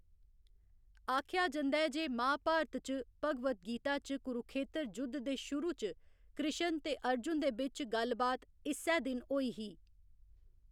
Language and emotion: Dogri, neutral